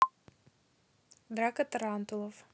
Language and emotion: Russian, neutral